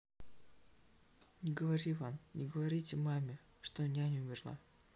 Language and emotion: Russian, sad